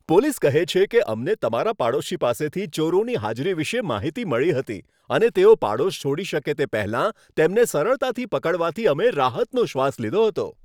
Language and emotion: Gujarati, happy